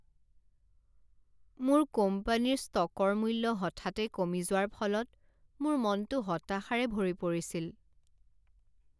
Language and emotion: Assamese, sad